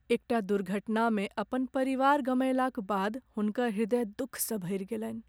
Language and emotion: Maithili, sad